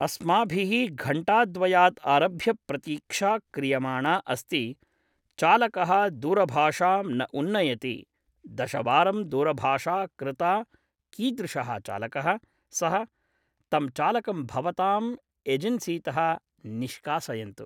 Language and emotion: Sanskrit, neutral